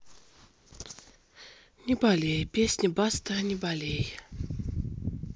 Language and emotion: Russian, sad